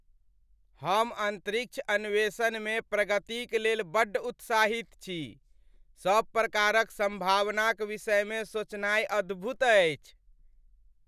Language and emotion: Maithili, happy